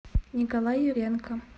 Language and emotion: Russian, neutral